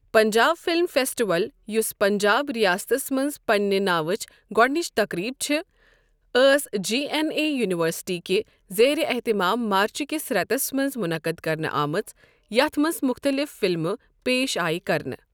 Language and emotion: Kashmiri, neutral